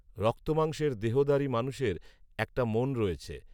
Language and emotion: Bengali, neutral